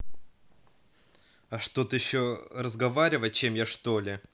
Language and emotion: Russian, angry